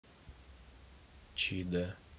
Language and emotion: Russian, neutral